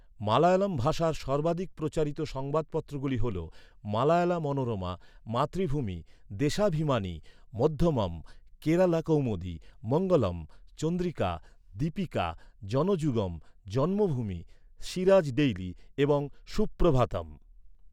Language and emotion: Bengali, neutral